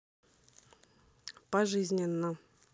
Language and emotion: Russian, neutral